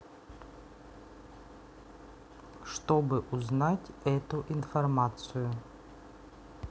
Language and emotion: Russian, neutral